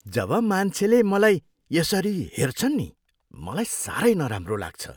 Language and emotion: Nepali, disgusted